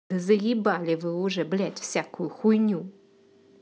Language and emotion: Russian, angry